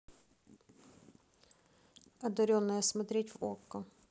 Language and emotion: Russian, neutral